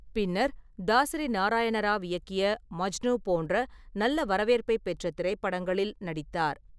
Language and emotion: Tamil, neutral